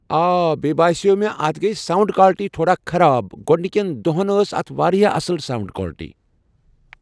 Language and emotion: Kashmiri, neutral